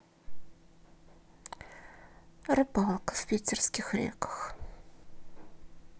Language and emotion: Russian, sad